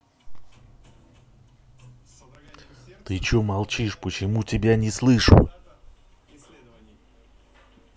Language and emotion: Russian, angry